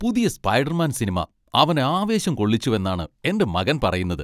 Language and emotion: Malayalam, happy